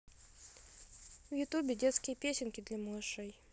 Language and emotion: Russian, neutral